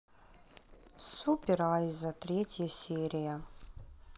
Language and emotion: Russian, sad